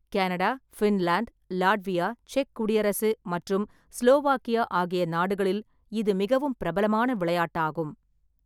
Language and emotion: Tamil, neutral